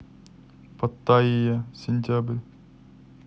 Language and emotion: Russian, neutral